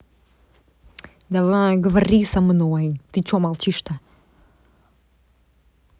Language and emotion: Russian, angry